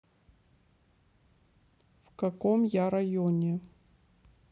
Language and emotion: Russian, neutral